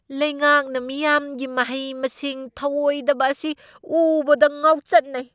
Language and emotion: Manipuri, angry